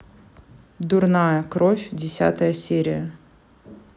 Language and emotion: Russian, neutral